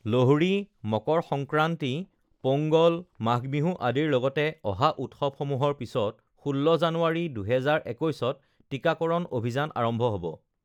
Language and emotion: Assamese, neutral